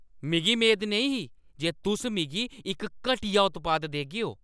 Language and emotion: Dogri, angry